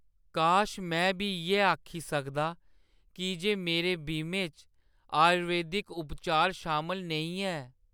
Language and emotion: Dogri, sad